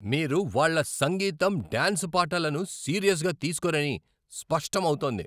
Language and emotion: Telugu, angry